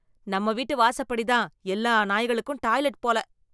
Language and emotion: Tamil, disgusted